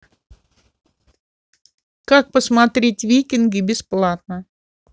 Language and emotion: Russian, neutral